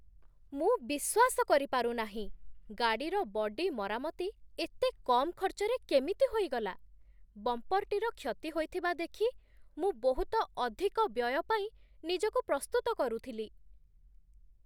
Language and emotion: Odia, surprised